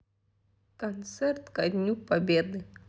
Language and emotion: Russian, sad